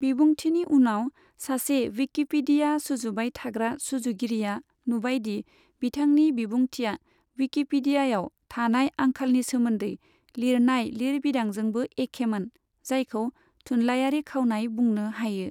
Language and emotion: Bodo, neutral